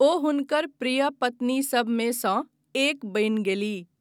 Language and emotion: Maithili, neutral